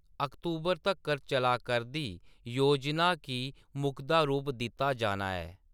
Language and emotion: Dogri, neutral